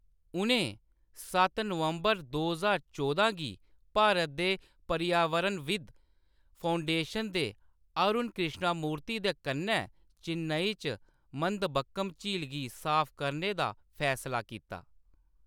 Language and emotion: Dogri, neutral